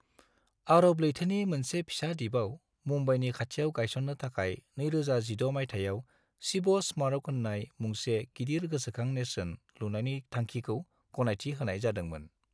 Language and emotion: Bodo, neutral